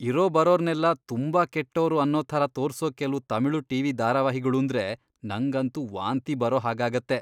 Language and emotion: Kannada, disgusted